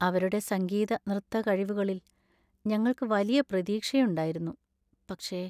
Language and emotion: Malayalam, sad